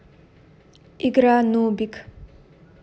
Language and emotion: Russian, neutral